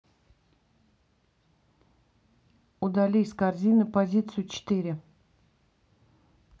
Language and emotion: Russian, neutral